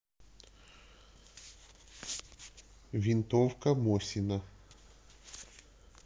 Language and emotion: Russian, neutral